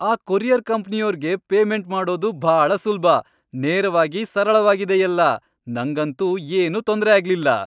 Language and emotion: Kannada, happy